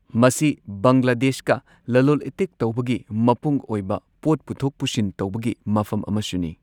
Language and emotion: Manipuri, neutral